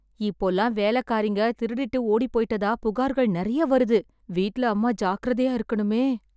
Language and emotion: Tamil, fearful